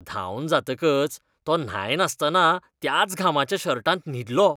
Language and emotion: Goan Konkani, disgusted